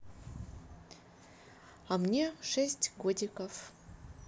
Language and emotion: Russian, neutral